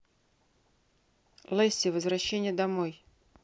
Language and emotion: Russian, neutral